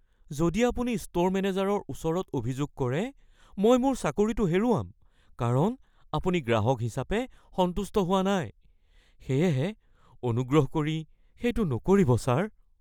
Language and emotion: Assamese, fearful